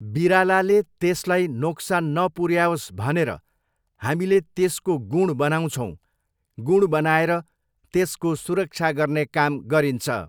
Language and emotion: Nepali, neutral